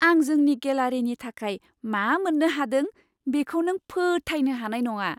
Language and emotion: Bodo, surprised